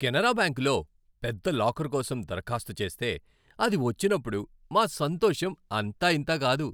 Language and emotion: Telugu, happy